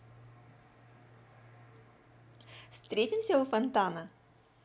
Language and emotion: Russian, positive